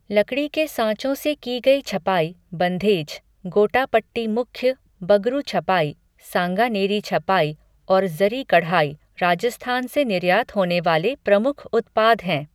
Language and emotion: Hindi, neutral